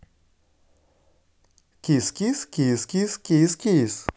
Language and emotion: Russian, positive